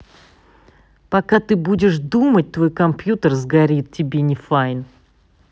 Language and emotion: Russian, angry